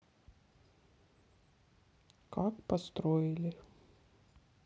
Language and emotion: Russian, sad